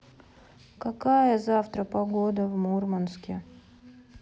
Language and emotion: Russian, sad